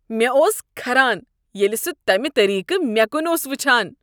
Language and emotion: Kashmiri, disgusted